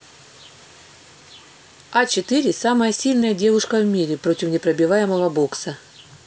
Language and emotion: Russian, neutral